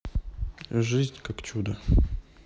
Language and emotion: Russian, neutral